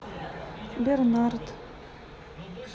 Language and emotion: Russian, neutral